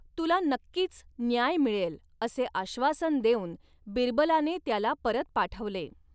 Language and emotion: Marathi, neutral